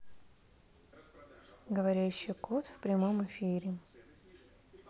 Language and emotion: Russian, neutral